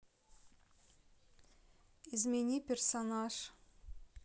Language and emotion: Russian, neutral